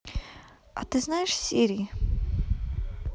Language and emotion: Russian, neutral